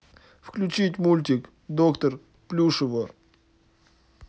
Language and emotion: Russian, sad